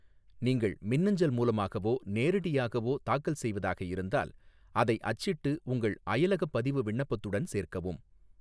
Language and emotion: Tamil, neutral